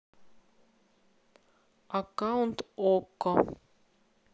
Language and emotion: Russian, neutral